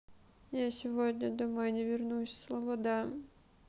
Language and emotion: Russian, sad